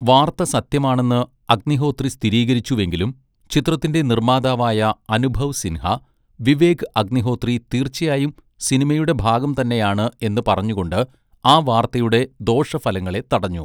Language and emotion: Malayalam, neutral